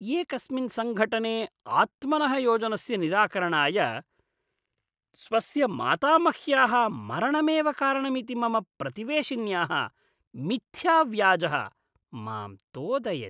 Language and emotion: Sanskrit, disgusted